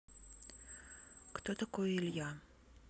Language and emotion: Russian, neutral